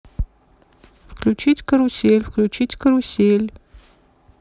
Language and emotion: Russian, neutral